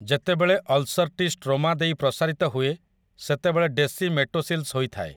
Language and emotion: Odia, neutral